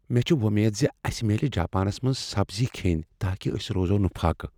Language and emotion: Kashmiri, fearful